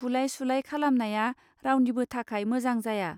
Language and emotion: Bodo, neutral